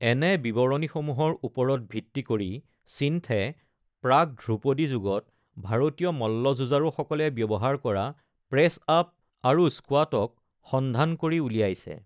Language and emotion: Assamese, neutral